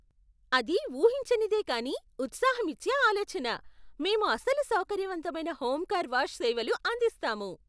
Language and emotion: Telugu, surprised